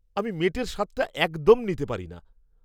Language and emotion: Bengali, disgusted